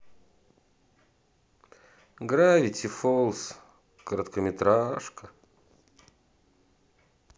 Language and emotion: Russian, sad